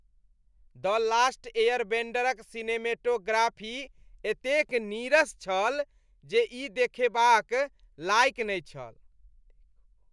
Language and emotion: Maithili, disgusted